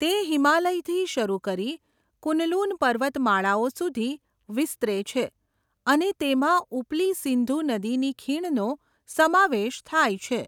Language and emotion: Gujarati, neutral